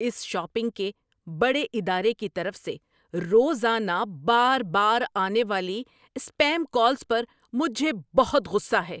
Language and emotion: Urdu, angry